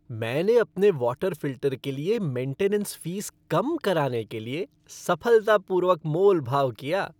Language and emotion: Hindi, happy